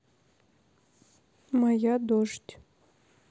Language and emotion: Russian, neutral